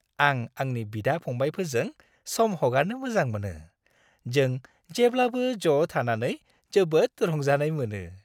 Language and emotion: Bodo, happy